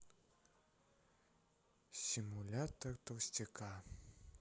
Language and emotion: Russian, sad